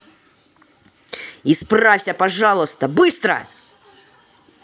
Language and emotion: Russian, angry